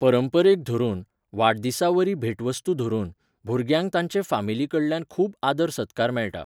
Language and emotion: Goan Konkani, neutral